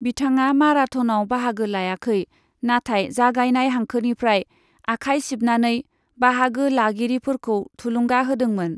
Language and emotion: Bodo, neutral